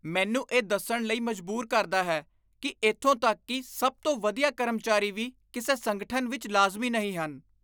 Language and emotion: Punjabi, disgusted